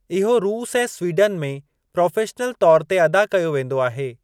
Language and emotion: Sindhi, neutral